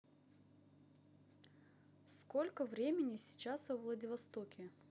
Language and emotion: Russian, neutral